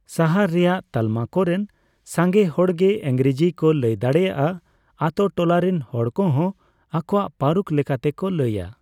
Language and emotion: Santali, neutral